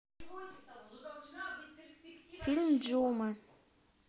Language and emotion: Russian, neutral